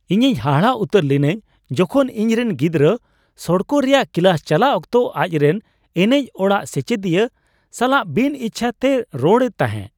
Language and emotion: Santali, surprised